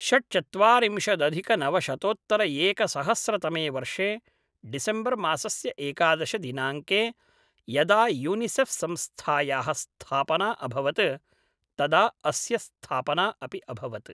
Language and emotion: Sanskrit, neutral